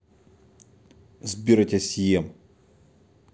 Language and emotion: Russian, angry